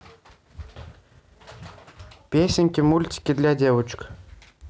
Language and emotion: Russian, neutral